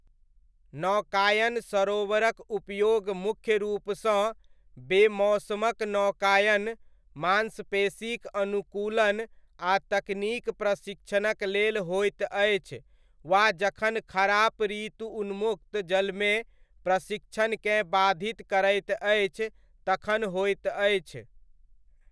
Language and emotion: Maithili, neutral